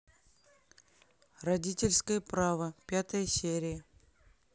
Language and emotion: Russian, neutral